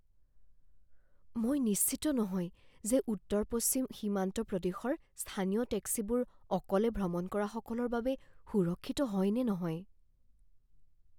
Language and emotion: Assamese, fearful